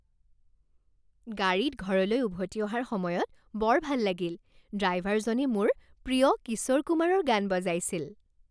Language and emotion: Assamese, happy